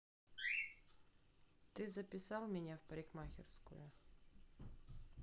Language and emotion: Russian, neutral